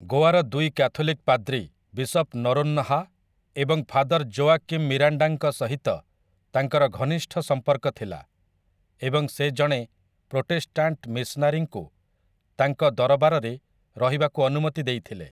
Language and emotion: Odia, neutral